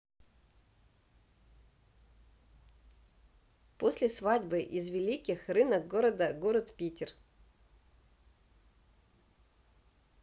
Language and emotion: Russian, neutral